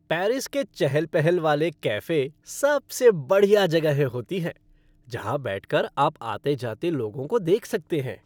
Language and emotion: Hindi, happy